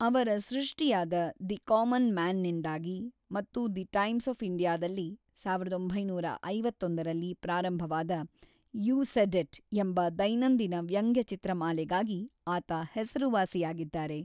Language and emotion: Kannada, neutral